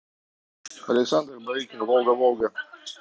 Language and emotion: Russian, neutral